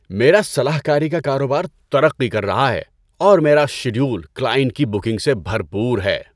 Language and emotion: Urdu, happy